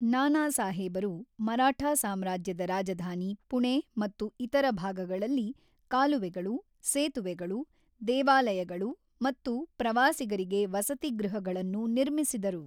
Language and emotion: Kannada, neutral